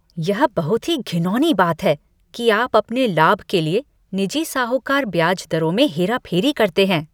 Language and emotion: Hindi, disgusted